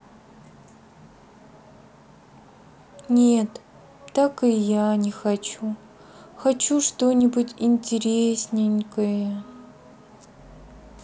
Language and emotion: Russian, sad